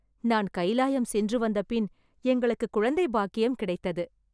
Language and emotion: Tamil, happy